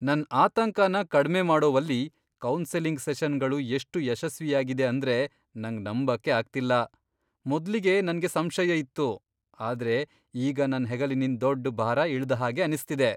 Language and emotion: Kannada, surprised